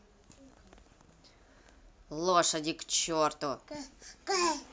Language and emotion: Russian, angry